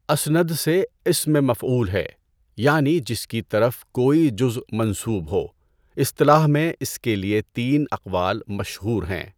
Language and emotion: Urdu, neutral